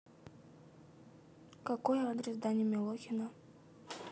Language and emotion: Russian, neutral